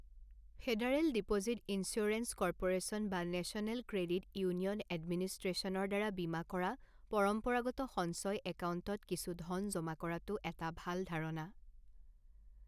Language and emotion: Assamese, neutral